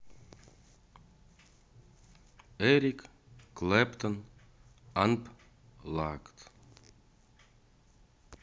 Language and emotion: Russian, neutral